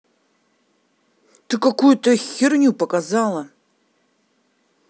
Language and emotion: Russian, angry